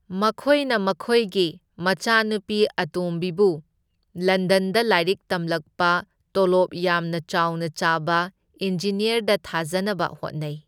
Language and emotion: Manipuri, neutral